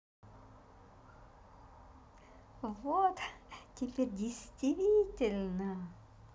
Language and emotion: Russian, positive